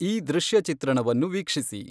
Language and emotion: Kannada, neutral